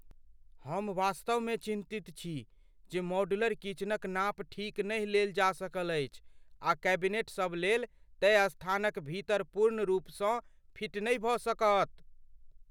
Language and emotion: Maithili, fearful